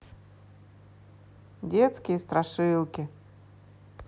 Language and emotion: Russian, neutral